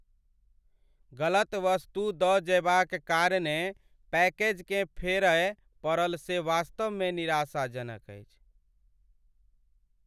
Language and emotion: Maithili, sad